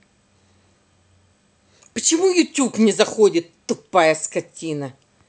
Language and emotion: Russian, angry